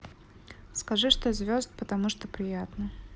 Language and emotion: Russian, neutral